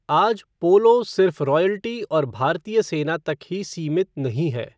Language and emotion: Hindi, neutral